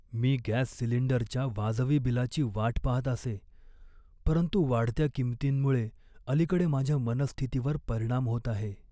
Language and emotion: Marathi, sad